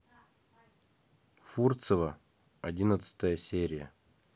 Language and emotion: Russian, neutral